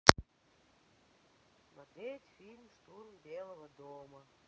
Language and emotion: Russian, neutral